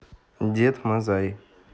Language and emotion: Russian, neutral